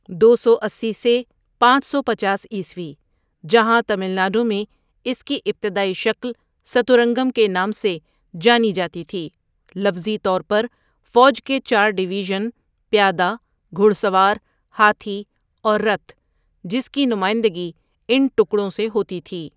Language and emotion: Urdu, neutral